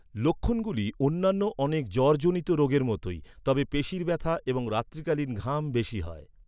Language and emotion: Bengali, neutral